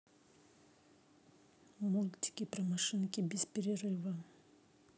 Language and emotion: Russian, neutral